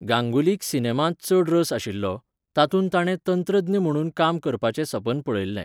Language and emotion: Goan Konkani, neutral